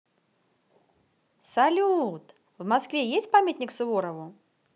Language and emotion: Russian, positive